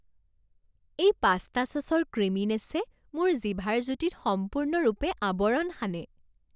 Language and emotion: Assamese, happy